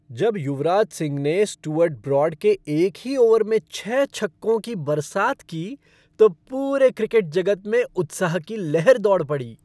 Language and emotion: Hindi, happy